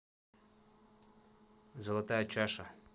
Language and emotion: Russian, neutral